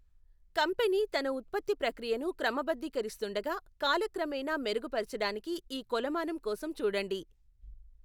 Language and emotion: Telugu, neutral